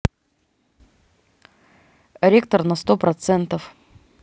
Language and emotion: Russian, neutral